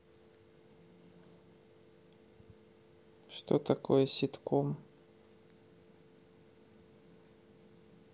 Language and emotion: Russian, neutral